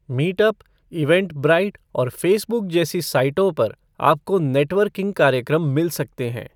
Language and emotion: Hindi, neutral